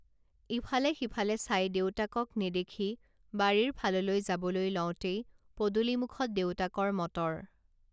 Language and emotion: Assamese, neutral